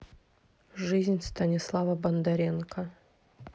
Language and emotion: Russian, neutral